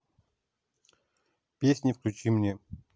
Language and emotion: Russian, neutral